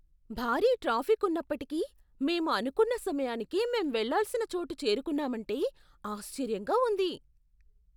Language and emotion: Telugu, surprised